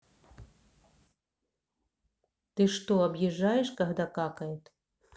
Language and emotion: Russian, neutral